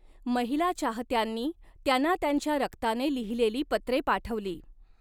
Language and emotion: Marathi, neutral